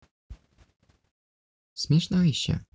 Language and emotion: Russian, neutral